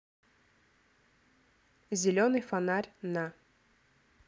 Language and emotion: Russian, neutral